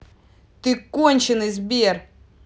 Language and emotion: Russian, angry